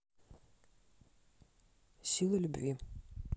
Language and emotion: Russian, neutral